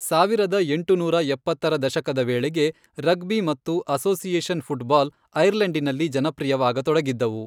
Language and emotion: Kannada, neutral